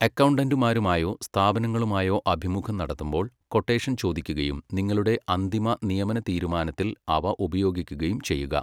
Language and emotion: Malayalam, neutral